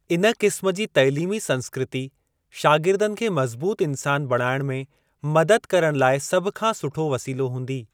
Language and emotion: Sindhi, neutral